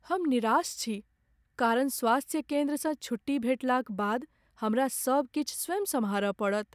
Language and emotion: Maithili, sad